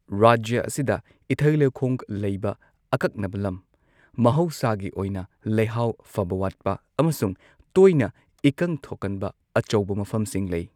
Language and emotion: Manipuri, neutral